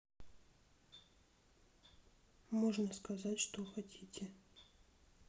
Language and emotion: Russian, sad